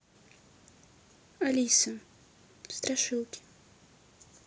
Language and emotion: Russian, neutral